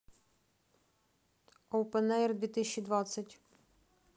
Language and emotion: Russian, neutral